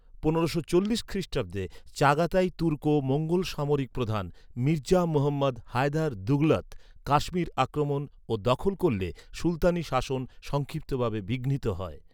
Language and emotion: Bengali, neutral